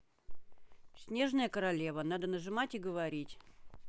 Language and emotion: Russian, angry